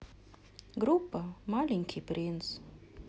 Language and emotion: Russian, sad